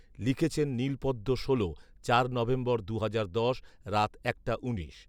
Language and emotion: Bengali, neutral